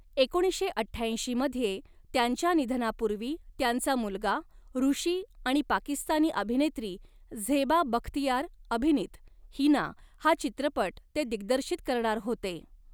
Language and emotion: Marathi, neutral